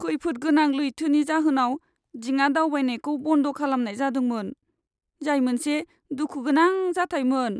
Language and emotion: Bodo, sad